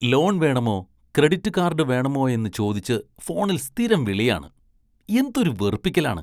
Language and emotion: Malayalam, disgusted